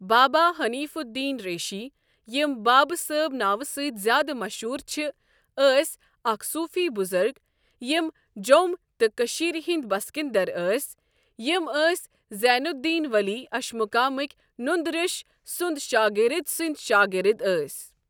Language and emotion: Kashmiri, neutral